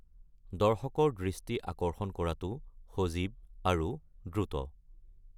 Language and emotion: Assamese, neutral